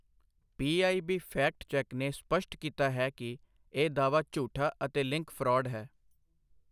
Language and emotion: Punjabi, neutral